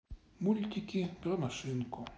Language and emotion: Russian, sad